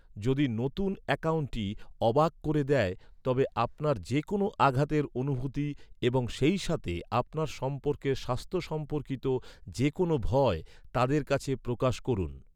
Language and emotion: Bengali, neutral